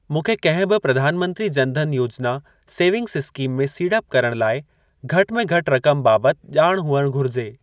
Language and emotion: Sindhi, neutral